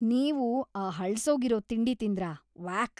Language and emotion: Kannada, disgusted